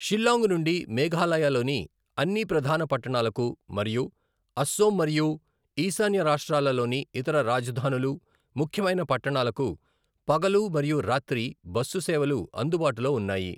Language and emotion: Telugu, neutral